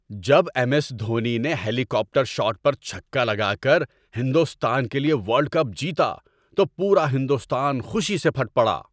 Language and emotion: Urdu, happy